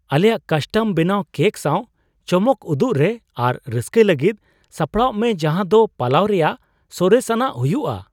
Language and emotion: Santali, surprised